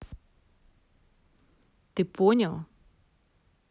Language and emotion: Russian, neutral